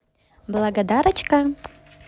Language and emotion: Russian, positive